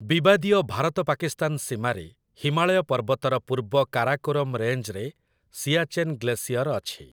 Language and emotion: Odia, neutral